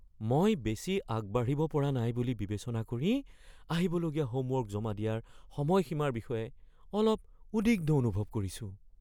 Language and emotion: Assamese, fearful